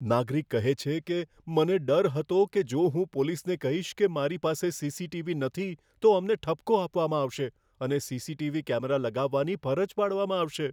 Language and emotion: Gujarati, fearful